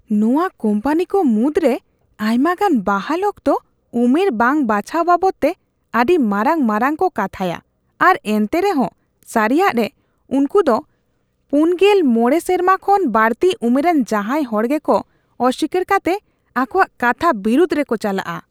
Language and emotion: Santali, disgusted